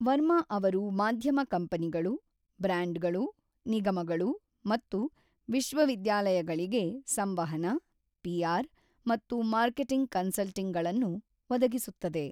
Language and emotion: Kannada, neutral